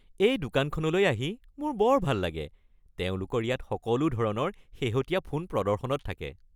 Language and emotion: Assamese, happy